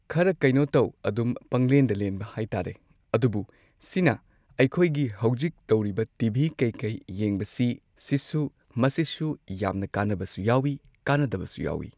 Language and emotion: Manipuri, neutral